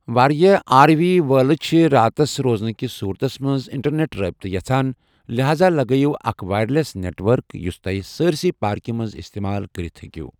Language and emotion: Kashmiri, neutral